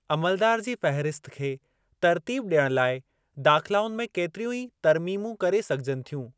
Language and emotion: Sindhi, neutral